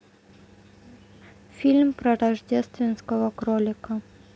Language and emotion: Russian, neutral